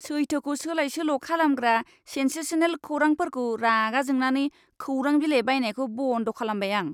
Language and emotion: Bodo, disgusted